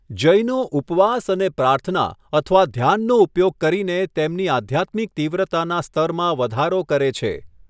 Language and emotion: Gujarati, neutral